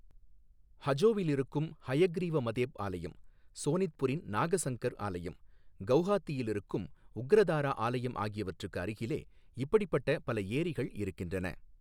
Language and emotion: Tamil, neutral